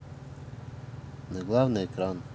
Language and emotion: Russian, neutral